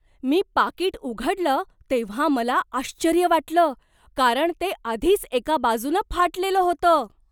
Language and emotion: Marathi, surprised